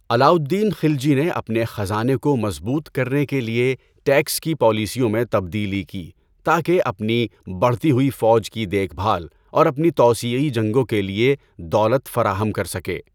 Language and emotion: Urdu, neutral